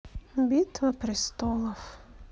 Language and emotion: Russian, sad